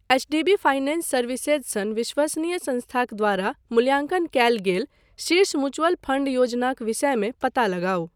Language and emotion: Maithili, neutral